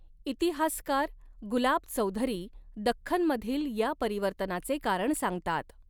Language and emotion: Marathi, neutral